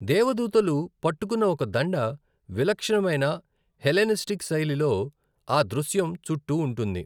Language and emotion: Telugu, neutral